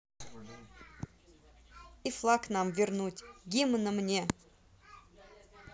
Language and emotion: Russian, neutral